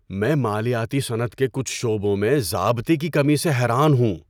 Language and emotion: Urdu, surprised